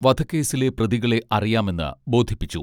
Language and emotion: Malayalam, neutral